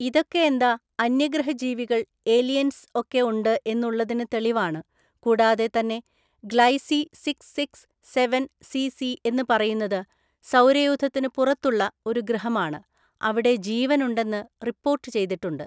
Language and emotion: Malayalam, neutral